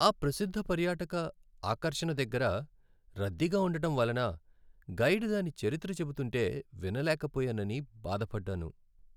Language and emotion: Telugu, sad